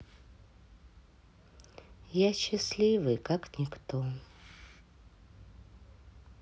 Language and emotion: Russian, sad